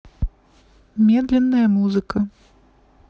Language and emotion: Russian, neutral